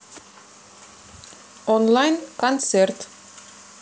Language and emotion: Russian, neutral